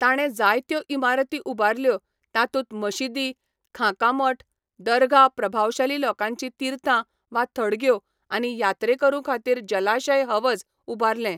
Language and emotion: Goan Konkani, neutral